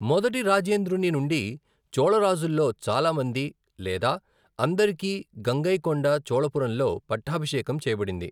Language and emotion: Telugu, neutral